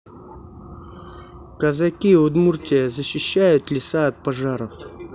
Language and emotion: Russian, neutral